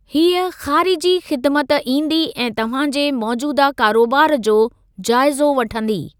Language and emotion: Sindhi, neutral